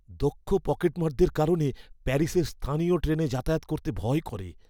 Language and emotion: Bengali, fearful